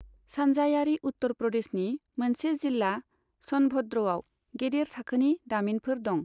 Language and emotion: Bodo, neutral